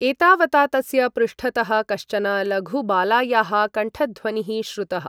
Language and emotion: Sanskrit, neutral